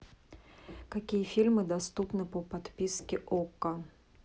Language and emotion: Russian, neutral